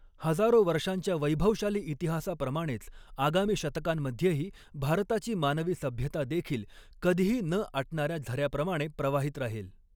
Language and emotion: Marathi, neutral